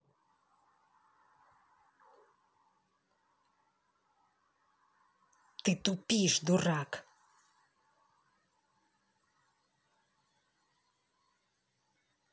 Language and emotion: Russian, angry